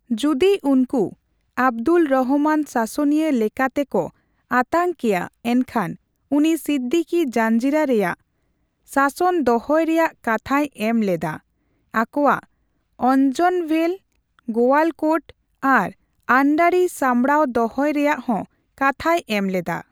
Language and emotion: Santali, neutral